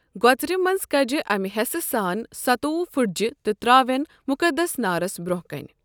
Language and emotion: Kashmiri, neutral